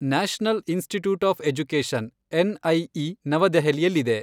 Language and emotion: Kannada, neutral